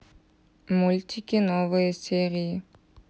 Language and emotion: Russian, neutral